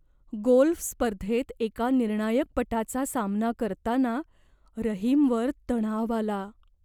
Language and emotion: Marathi, fearful